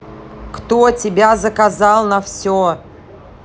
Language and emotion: Russian, angry